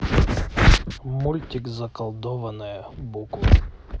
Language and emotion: Russian, neutral